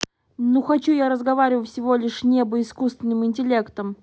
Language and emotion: Russian, angry